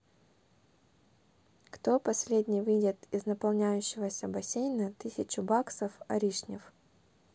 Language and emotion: Russian, neutral